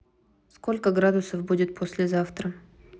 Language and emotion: Russian, neutral